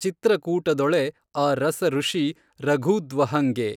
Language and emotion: Kannada, neutral